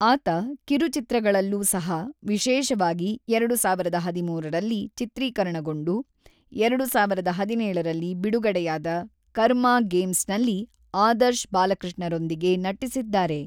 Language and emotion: Kannada, neutral